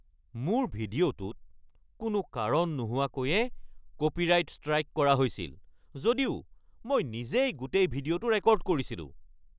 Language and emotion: Assamese, angry